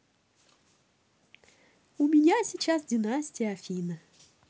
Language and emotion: Russian, positive